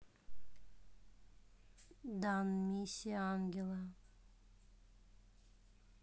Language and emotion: Russian, neutral